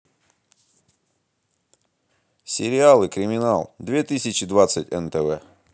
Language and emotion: Russian, neutral